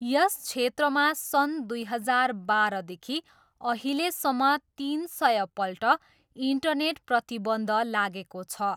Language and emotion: Nepali, neutral